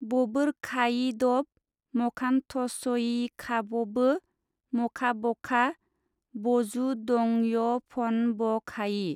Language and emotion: Bodo, neutral